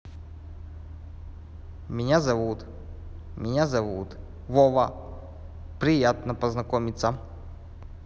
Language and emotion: Russian, neutral